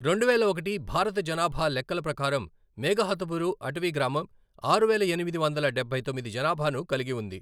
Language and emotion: Telugu, neutral